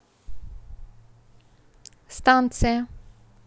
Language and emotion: Russian, neutral